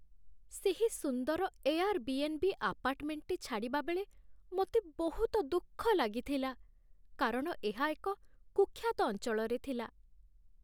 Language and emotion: Odia, sad